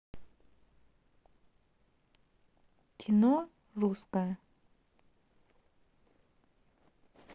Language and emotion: Russian, neutral